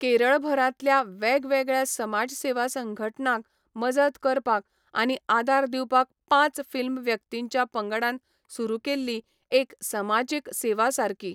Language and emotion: Goan Konkani, neutral